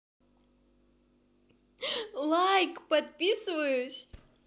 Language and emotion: Russian, positive